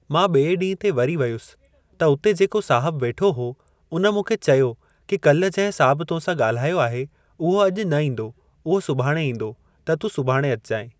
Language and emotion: Sindhi, neutral